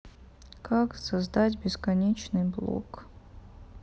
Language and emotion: Russian, sad